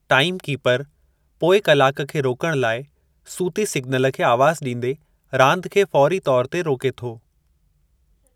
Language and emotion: Sindhi, neutral